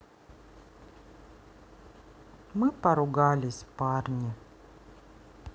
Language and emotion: Russian, sad